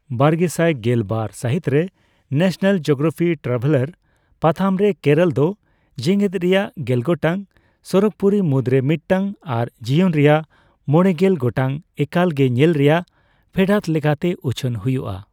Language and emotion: Santali, neutral